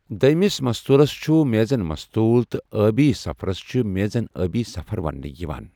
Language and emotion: Kashmiri, neutral